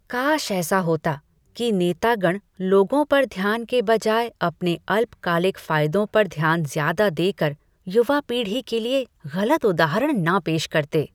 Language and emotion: Hindi, disgusted